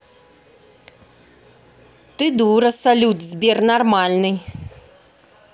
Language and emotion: Russian, angry